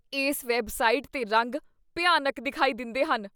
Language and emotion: Punjabi, disgusted